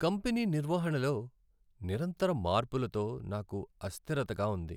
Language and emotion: Telugu, sad